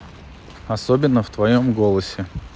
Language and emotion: Russian, neutral